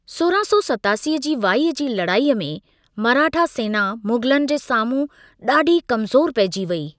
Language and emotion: Sindhi, neutral